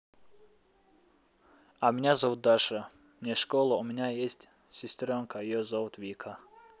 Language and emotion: Russian, neutral